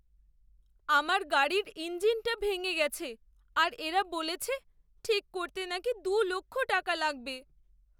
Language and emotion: Bengali, sad